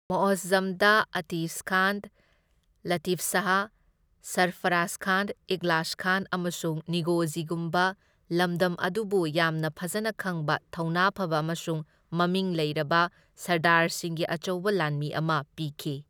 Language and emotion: Manipuri, neutral